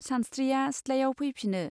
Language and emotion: Bodo, neutral